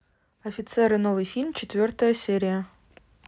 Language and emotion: Russian, neutral